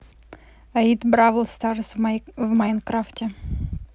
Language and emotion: Russian, neutral